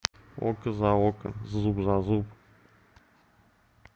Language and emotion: Russian, neutral